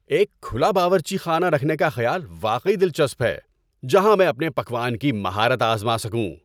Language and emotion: Urdu, happy